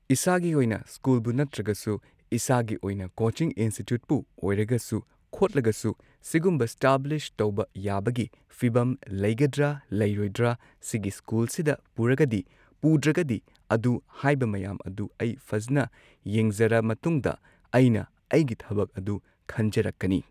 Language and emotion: Manipuri, neutral